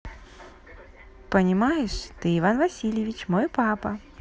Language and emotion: Russian, positive